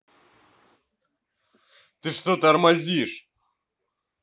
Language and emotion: Russian, angry